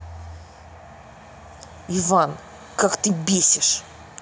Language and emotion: Russian, angry